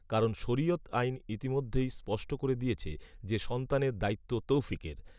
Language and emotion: Bengali, neutral